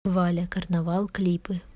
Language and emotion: Russian, neutral